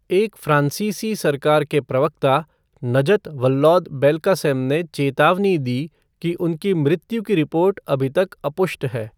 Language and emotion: Hindi, neutral